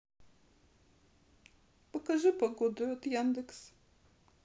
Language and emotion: Russian, sad